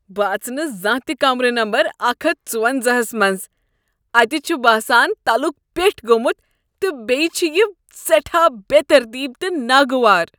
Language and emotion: Kashmiri, disgusted